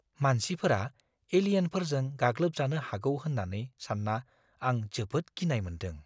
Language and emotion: Bodo, fearful